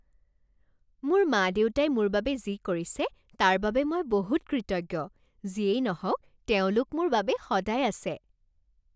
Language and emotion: Assamese, happy